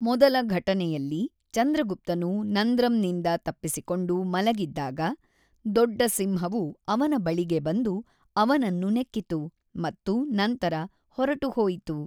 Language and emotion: Kannada, neutral